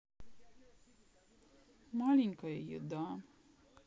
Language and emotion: Russian, sad